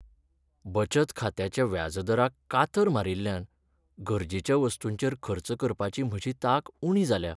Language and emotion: Goan Konkani, sad